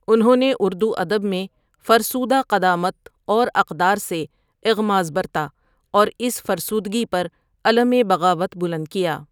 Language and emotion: Urdu, neutral